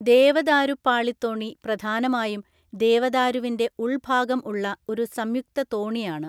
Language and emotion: Malayalam, neutral